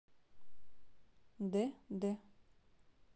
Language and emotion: Russian, neutral